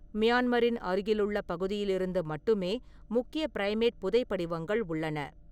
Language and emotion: Tamil, neutral